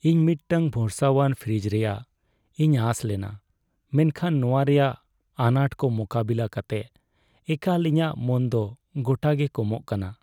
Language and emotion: Santali, sad